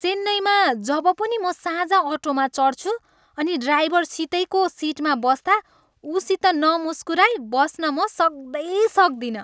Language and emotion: Nepali, happy